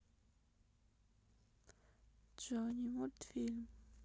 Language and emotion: Russian, sad